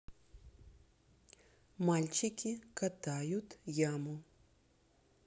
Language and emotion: Russian, neutral